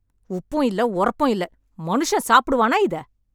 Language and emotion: Tamil, angry